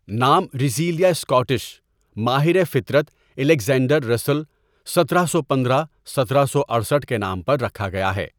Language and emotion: Urdu, neutral